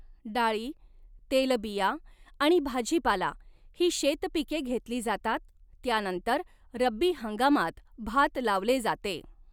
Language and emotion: Marathi, neutral